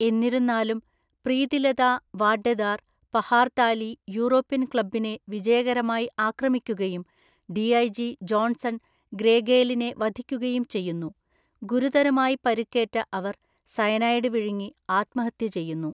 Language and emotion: Malayalam, neutral